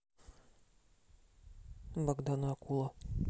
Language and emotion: Russian, neutral